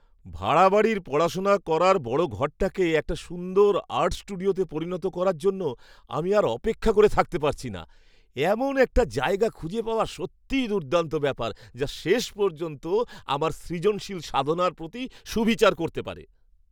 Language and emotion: Bengali, happy